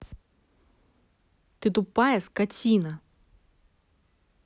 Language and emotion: Russian, angry